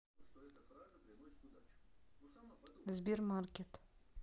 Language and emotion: Russian, neutral